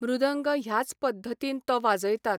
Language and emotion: Goan Konkani, neutral